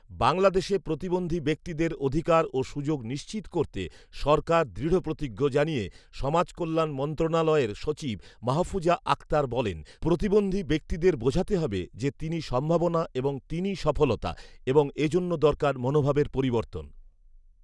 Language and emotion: Bengali, neutral